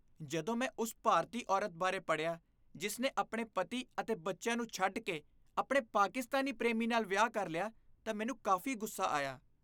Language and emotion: Punjabi, disgusted